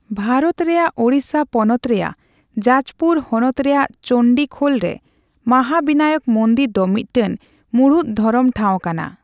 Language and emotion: Santali, neutral